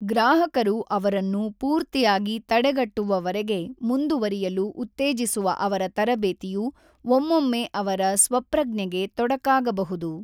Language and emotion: Kannada, neutral